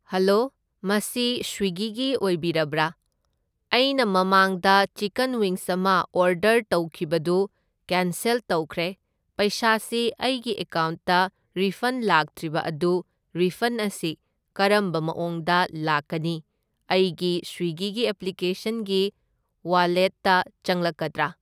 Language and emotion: Manipuri, neutral